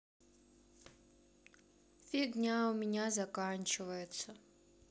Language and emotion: Russian, sad